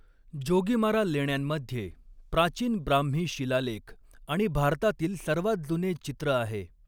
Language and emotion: Marathi, neutral